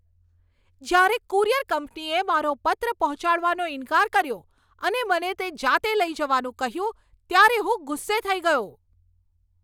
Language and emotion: Gujarati, angry